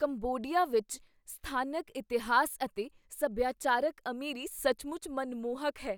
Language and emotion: Punjabi, surprised